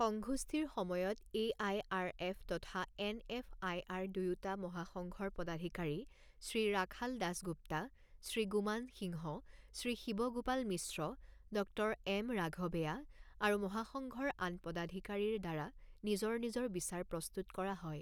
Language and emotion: Assamese, neutral